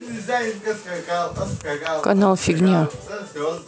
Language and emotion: Russian, neutral